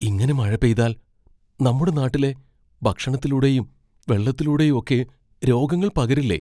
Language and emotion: Malayalam, fearful